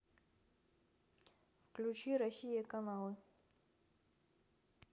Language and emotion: Russian, neutral